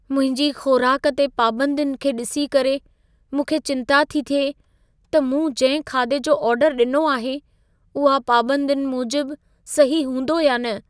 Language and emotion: Sindhi, fearful